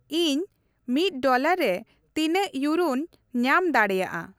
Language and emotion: Santali, neutral